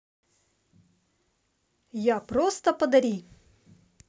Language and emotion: Russian, positive